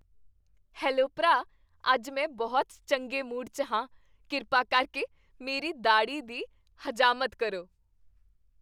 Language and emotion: Punjabi, happy